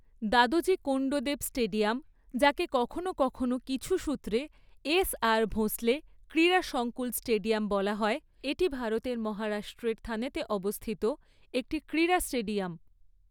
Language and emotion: Bengali, neutral